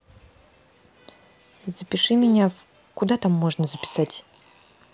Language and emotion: Russian, neutral